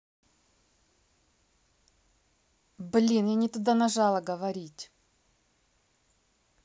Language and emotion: Russian, angry